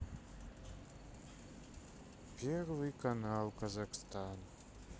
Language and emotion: Russian, sad